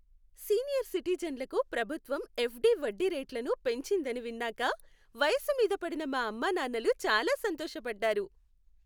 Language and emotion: Telugu, happy